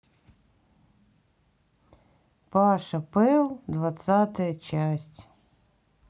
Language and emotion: Russian, sad